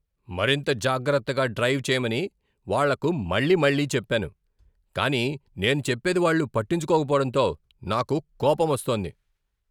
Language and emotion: Telugu, angry